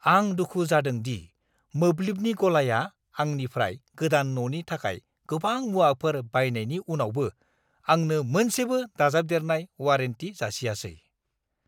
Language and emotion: Bodo, angry